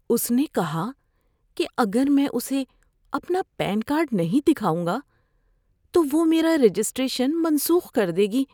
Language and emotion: Urdu, fearful